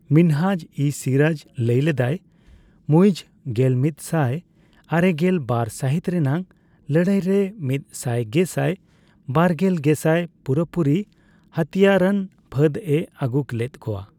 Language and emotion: Santali, neutral